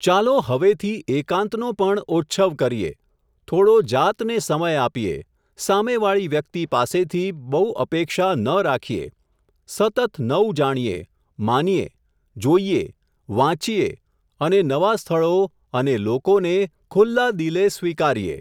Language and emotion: Gujarati, neutral